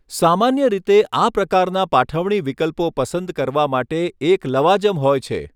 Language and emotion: Gujarati, neutral